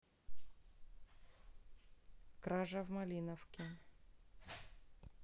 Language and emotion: Russian, neutral